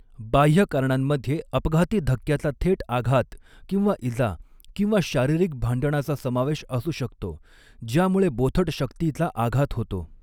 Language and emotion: Marathi, neutral